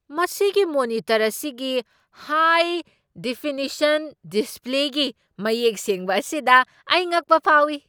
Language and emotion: Manipuri, surprised